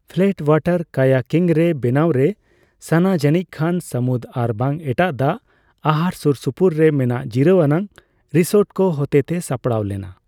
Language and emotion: Santali, neutral